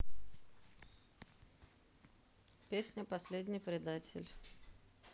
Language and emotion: Russian, neutral